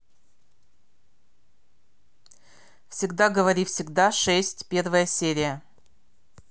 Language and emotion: Russian, neutral